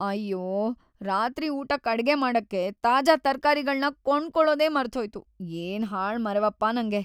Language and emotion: Kannada, sad